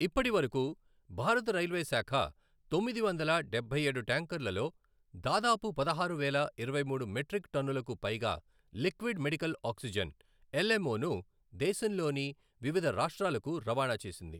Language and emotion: Telugu, neutral